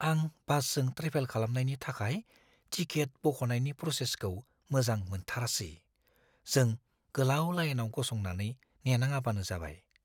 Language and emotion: Bodo, fearful